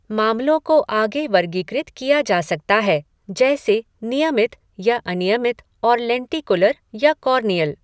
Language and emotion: Hindi, neutral